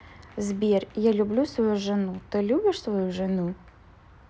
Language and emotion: Russian, neutral